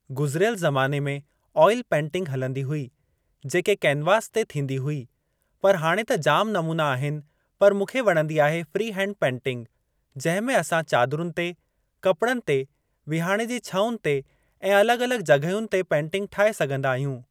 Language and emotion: Sindhi, neutral